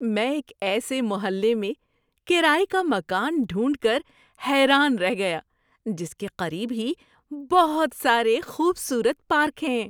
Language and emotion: Urdu, surprised